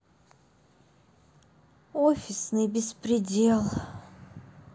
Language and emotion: Russian, sad